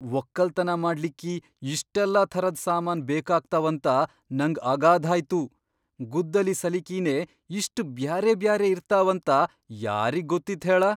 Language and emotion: Kannada, surprised